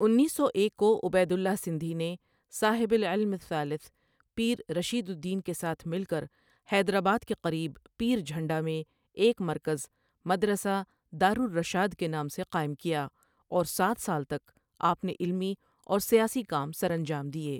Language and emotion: Urdu, neutral